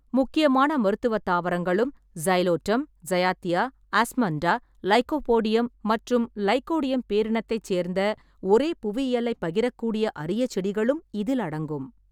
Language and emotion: Tamil, neutral